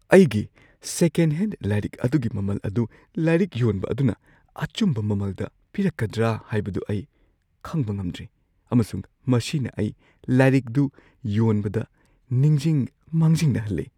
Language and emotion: Manipuri, fearful